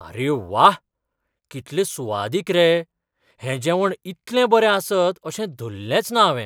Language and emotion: Goan Konkani, surprised